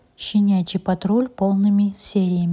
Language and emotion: Russian, neutral